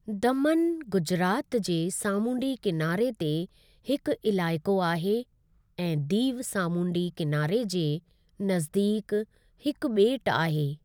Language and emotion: Sindhi, neutral